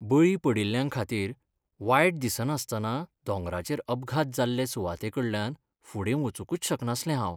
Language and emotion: Goan Konkani, sad